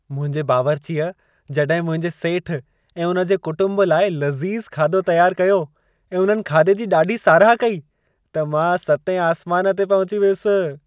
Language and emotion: Sindhi, happy